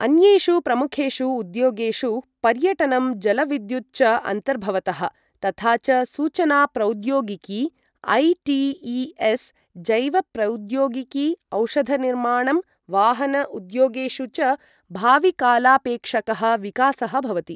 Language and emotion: Sanskrit, neutral